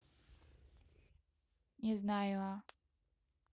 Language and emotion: Russian, neutral